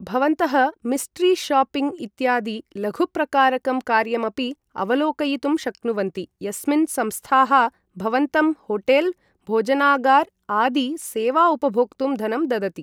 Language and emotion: Sanskrit, neutral